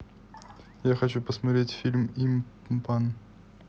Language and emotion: Russian, neutral